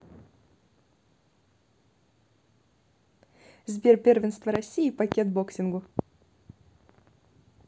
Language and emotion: Russian, neutral